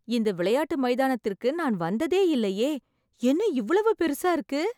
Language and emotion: Tamil, surprised